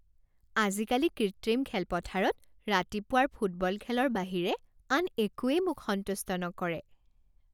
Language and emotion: Assamese, happy